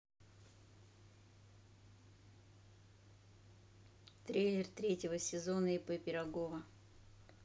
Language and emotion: Russian, neutral